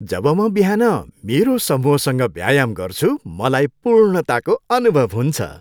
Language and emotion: Nepali, happy